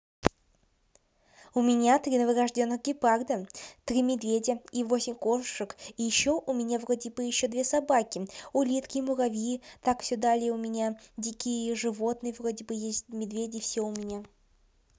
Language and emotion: Russian, positive